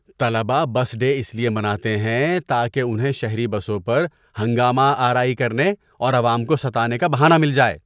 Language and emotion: Urdu, disgusted